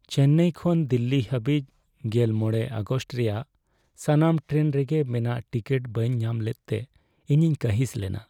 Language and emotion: Santali, sad